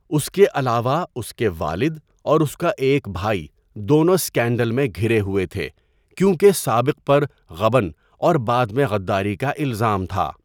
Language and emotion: Urdu, neutral